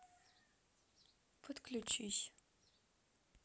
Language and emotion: Russian, sad